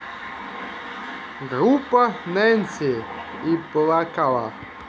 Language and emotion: Russian, positive